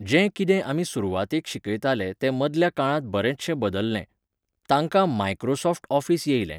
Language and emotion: Goan Konkani, neutral